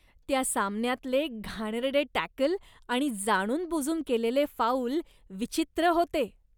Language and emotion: Marathi, disgusted